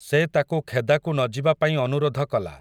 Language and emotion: Odia, neutral